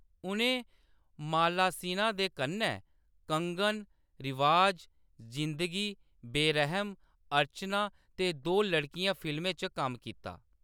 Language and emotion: Dogri, neutral